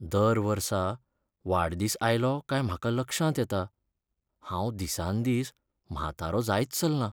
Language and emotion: Goan Konkani, sad